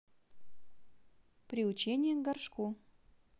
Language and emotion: Russian, neutral